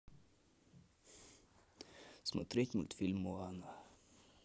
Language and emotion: Russian, neutral